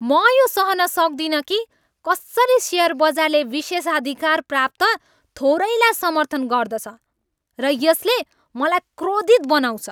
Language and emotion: Nepali, angry